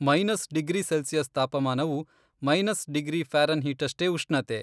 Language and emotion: Kannada, neutral